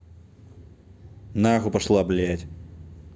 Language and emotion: Russian, angry